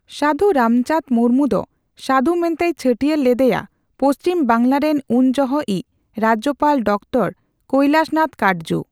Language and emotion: Santali, neutral